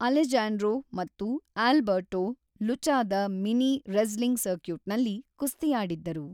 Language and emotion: Kannada, neutral